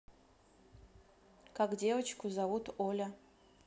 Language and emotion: Russian, neutral